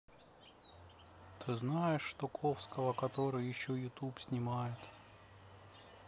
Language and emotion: Russian, sad